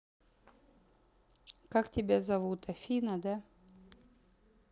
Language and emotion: Russian, neutral